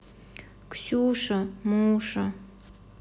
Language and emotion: Russian, sad